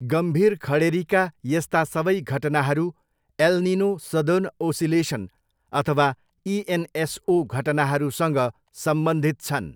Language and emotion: Nepali, neutral